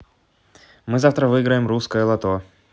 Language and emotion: Russian, positive